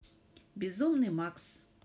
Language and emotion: Russian, neutral